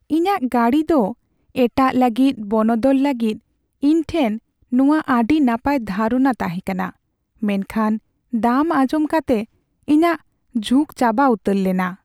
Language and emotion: Santali, sad